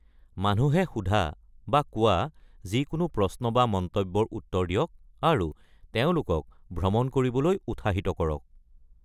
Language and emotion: Assamese, neutral